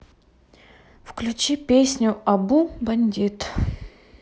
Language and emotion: Russian, neutral